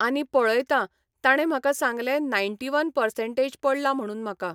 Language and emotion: Goan Konkani, neutral